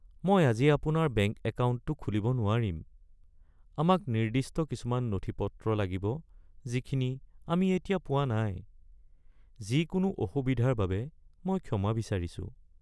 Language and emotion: Assamese, sad